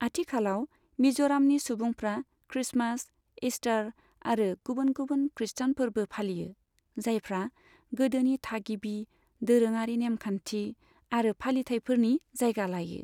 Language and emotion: Bodo, neutral